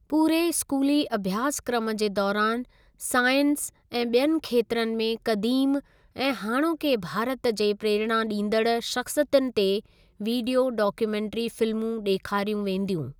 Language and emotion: Sindhi, neutral